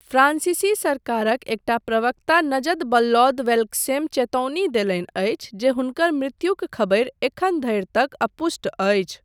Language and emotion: Maithili, neutral